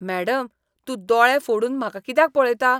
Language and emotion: Goan Konkani, disgusted